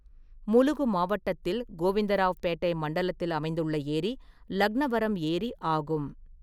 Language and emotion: Tamil, neutral